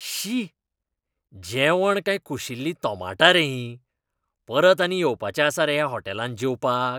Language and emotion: Goan Konkani, disgusted